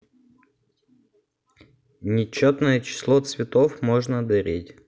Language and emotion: Russian, neutral